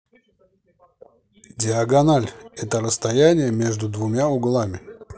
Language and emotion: Russian, neutral